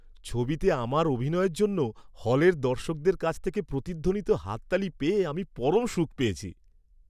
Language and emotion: Bengali, happy